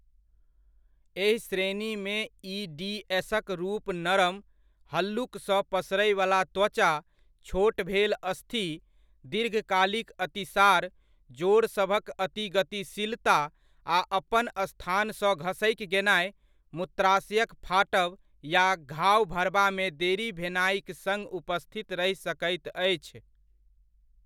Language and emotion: Maithili, neutral